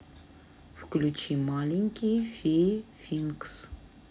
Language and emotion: Russian, neutral